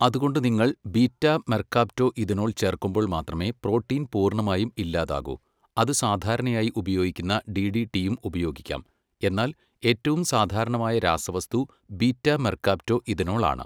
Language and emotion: Malayalam, neutral